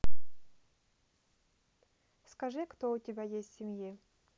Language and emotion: Russian, neutral